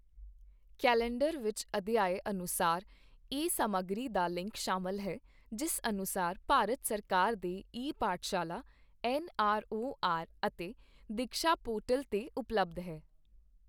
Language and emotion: Punjabi, neutral